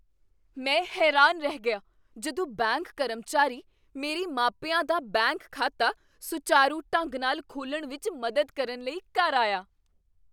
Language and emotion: Punjabi, surprised